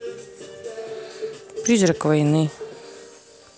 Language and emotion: Russian, neutral